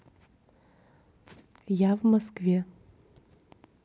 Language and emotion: Russian, neutral